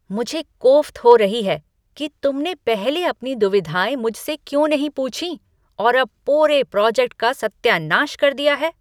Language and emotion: Hindi, angry